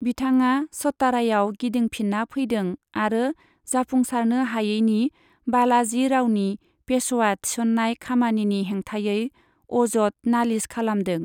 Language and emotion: Bodo, neutral